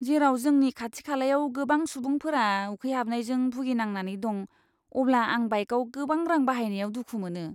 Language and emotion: Bodo, disgusted